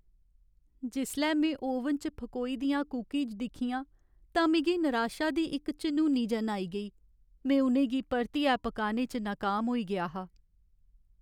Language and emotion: Dogri, sad